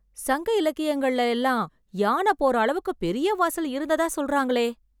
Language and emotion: Tamil, surprised